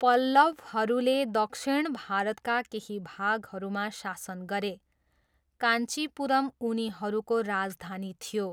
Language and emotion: Nepali, neutral